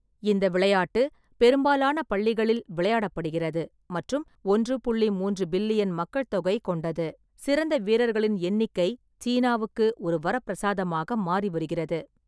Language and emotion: Tamil, neutral